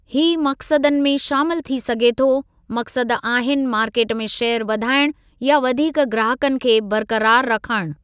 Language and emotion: Sindhi, neutral